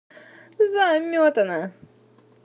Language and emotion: Russian, positive